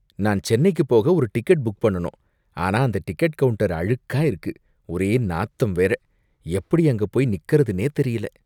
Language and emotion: Tamil, disgusted